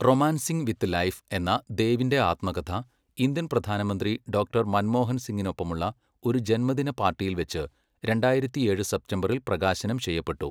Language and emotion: Malayalam, neutral